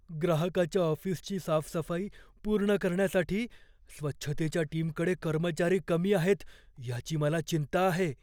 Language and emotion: Marathi, fearful